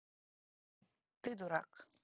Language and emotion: Russian, neutral